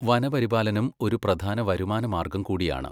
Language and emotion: Malayalam, neutral